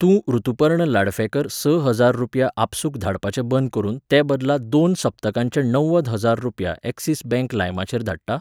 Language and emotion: Goan Konkani, neutral